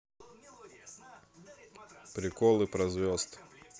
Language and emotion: Russian, neutral